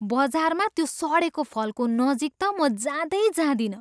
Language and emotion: Nepali, disgusted